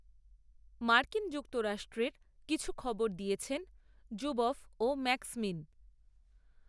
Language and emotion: Bengali, neutral